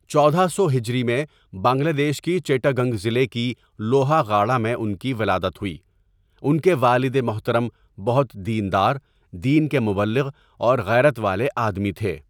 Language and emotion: Urdu, neutral